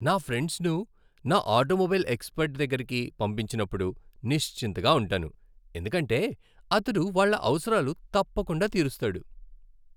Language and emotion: Telugu, happy